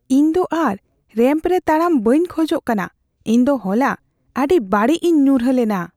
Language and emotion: Santali, fearful